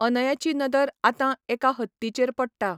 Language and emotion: Goan Konkani, neutral